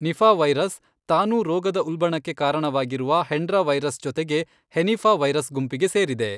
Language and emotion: Kannada, neutral